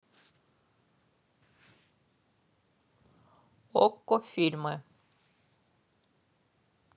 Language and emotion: Russian, neutral